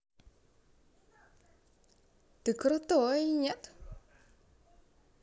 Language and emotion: Russian, neutral